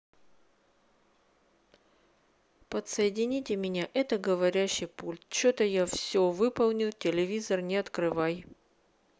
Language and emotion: Russian, neutral